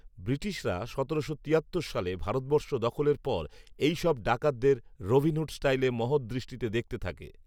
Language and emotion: Bengali, neutral